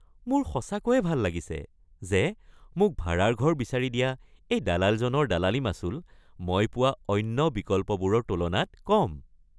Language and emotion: Assamese, happy